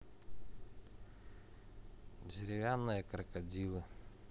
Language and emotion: Russian, neutral